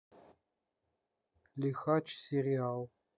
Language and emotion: Russian, neutral